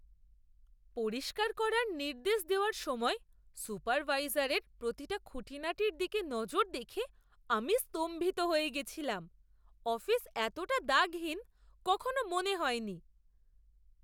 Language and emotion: Bengali, surprised